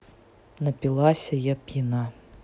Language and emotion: Russian, neutral